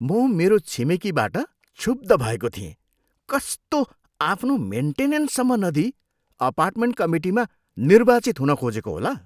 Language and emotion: Nepali, disgusted